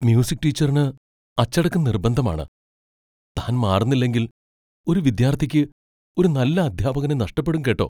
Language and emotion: Malayalam, fearful